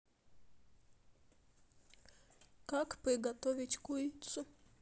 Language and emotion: Russian, sad